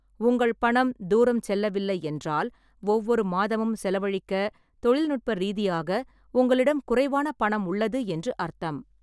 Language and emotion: Tamil, neutral